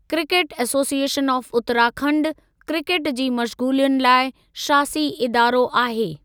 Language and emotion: Sindhi, neutral